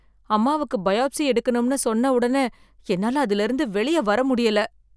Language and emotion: Tamil, fearful